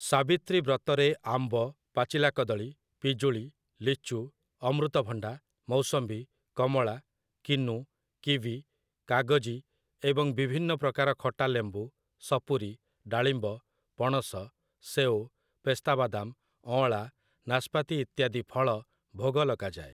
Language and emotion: Odia, neutral